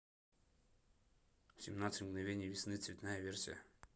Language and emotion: Russian, neutral